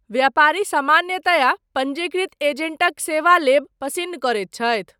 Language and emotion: Maithili, neutral